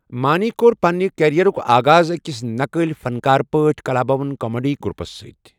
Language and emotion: Kashmiri, neutral